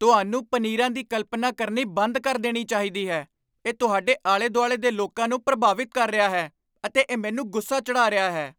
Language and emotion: Punjabi, angry